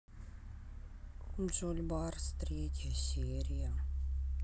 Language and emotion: Russian, sad